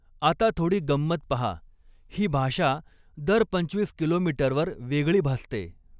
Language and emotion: Marathi, neutral